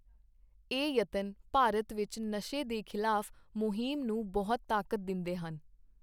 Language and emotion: Punjabi, neutral